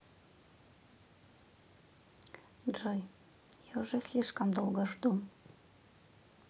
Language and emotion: Russian, sad